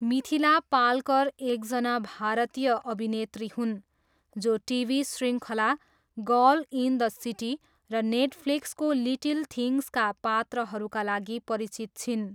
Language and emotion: Nepali, neutral